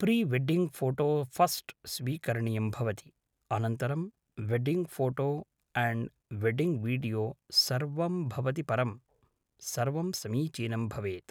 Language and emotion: Sanskrit, neutral